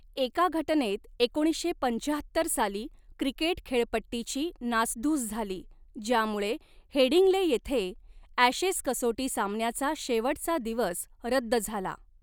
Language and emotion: Marathi, neutral